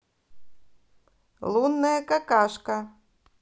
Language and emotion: Russian, positive